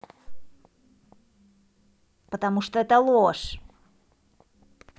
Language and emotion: Russian, angry